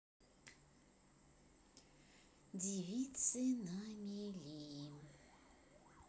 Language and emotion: Russian, neutral